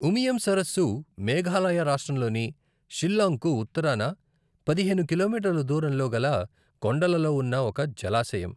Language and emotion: Telugu, neutral